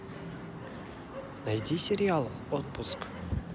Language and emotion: Russian, positive